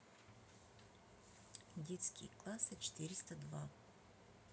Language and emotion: Russian, neutral